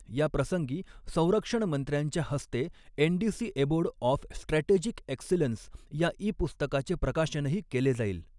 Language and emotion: Marathi, neutral